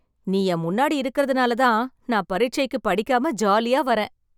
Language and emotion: Tamil, happy